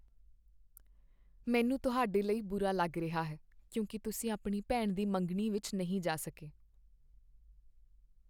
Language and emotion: Punjabi, sad